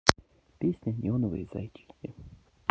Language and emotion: Russian, neutral